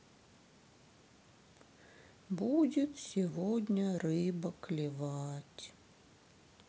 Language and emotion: Russian, sad